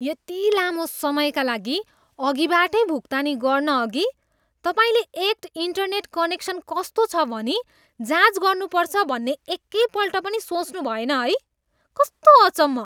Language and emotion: Nepali, disgusted